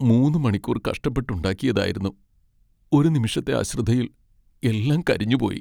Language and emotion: Malayalam, sad